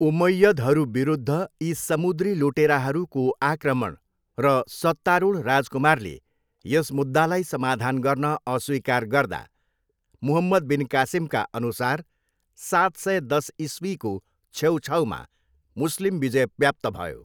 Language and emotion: Nepali, neutral